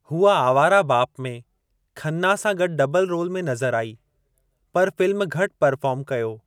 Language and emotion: Sindhi, neutral